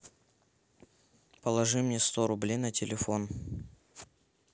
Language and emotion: Russian, neutral